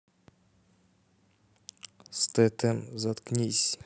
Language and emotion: Russian, neutral